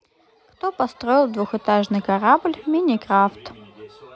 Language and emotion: Russian, neutral